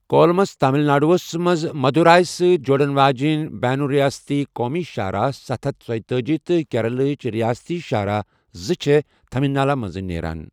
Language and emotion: Kashmiri, neutral